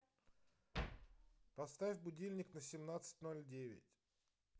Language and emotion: Russian, neutral